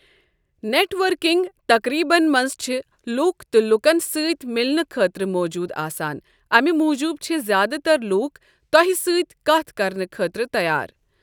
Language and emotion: Kashmiri, neutral